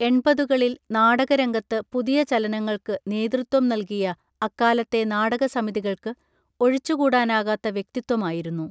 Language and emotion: Malayalam, neutral